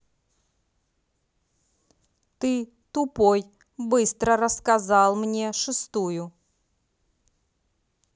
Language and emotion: Russian, angry